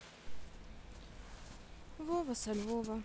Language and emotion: Russian, sad